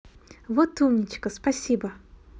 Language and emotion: Russian, positive